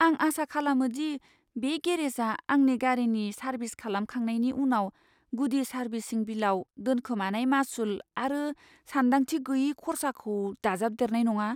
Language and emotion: Bodo, fearful